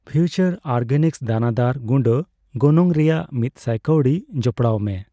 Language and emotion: Santali, neutral